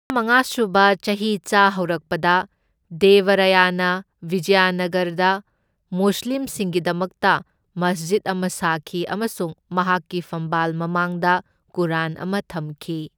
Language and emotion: Manipuri, neutral